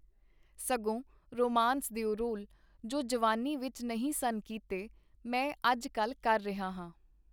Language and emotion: Punjabi, neutral